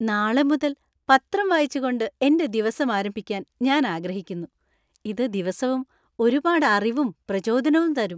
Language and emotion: Malayalam, happy